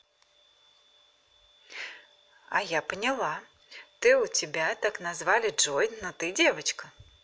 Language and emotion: Russian, positive